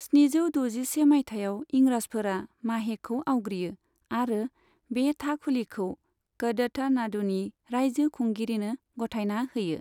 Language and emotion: Bodo, neutral